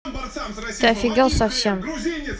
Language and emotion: Russian, angry